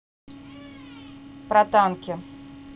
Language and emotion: Russian, neutral